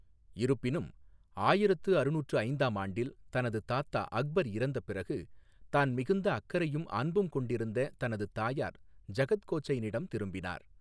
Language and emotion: Tamil, neutral